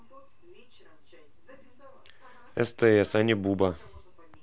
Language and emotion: Russian, neutral